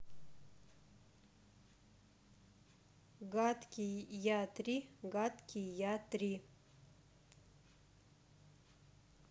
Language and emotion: Russian, neutral